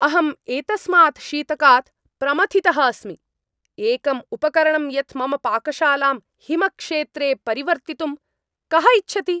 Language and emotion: Sanskrit, angry